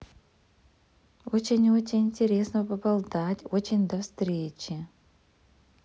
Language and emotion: Russian, positive